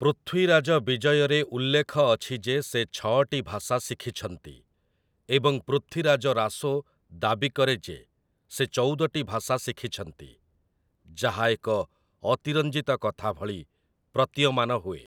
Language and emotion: Odia, neutral